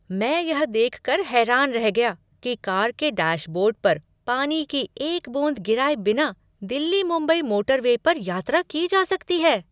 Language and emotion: Hindi, surprised